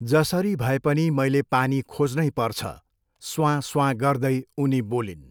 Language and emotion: Nepali, neutral